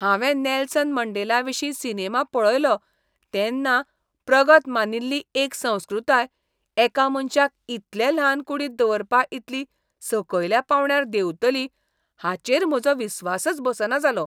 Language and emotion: Goan Konkani, disgusted